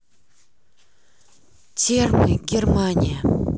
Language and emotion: Russian, neutral